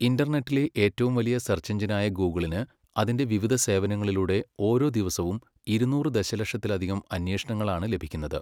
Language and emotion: Malayalam, neutral